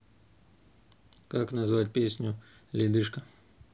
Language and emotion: Russian, neutral